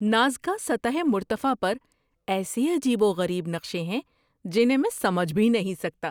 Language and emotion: Urdu, surprised